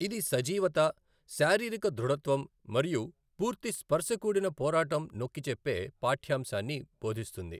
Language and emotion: Telugu, neutral